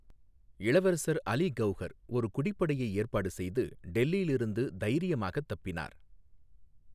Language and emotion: Tamil, neutral